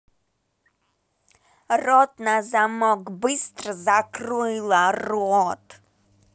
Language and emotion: Russian, angry